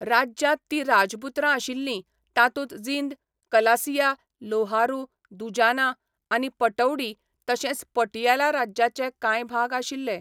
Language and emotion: Goan Konkani, neutral